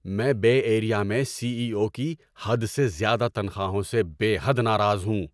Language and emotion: Urdu, angry